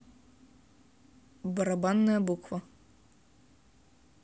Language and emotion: Russian, neutral